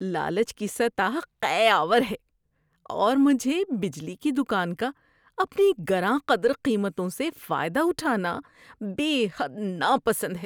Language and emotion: Urdu, disgusted